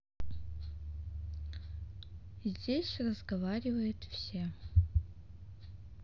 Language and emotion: Russian, neutral